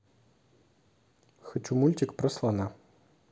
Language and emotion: Russian, neutral